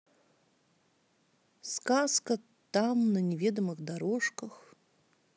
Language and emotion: Russian, neutral